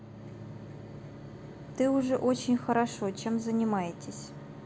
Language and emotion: Russian, neutral